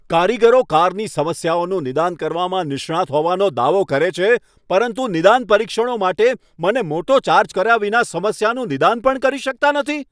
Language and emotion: Gujarati, angry